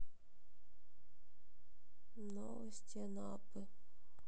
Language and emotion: Russian, sad